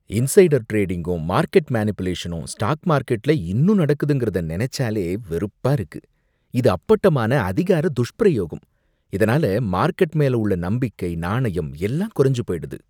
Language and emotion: Tamil, disgusted